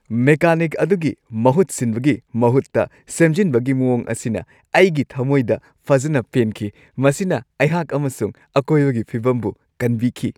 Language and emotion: Manipuri, happy